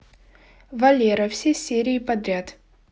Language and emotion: Russian, neutral